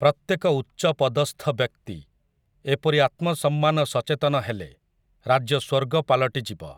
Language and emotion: Odia, neutral